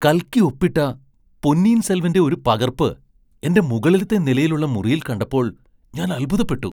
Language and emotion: Malayalam, surprised